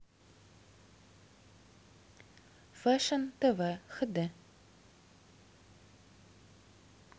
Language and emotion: Russian, neutral